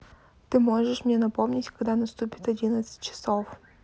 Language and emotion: Russian, neutral